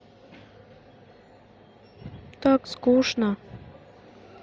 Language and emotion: Russian, sad